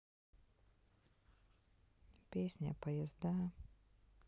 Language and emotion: Russian, sad